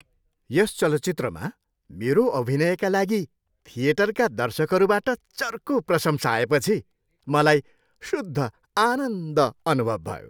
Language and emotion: Nepali, happy